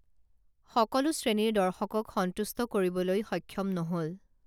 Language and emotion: Assamese, neutral